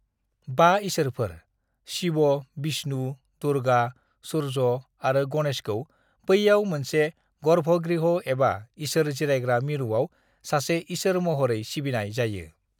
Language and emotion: Bodo, neutral